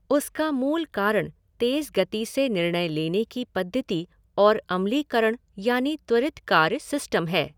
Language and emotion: Hindi, neutral